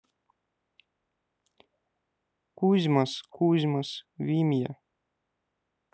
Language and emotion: Russian, neutral